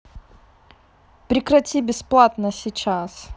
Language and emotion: Russian, angry